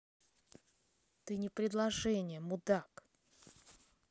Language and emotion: Russian, angry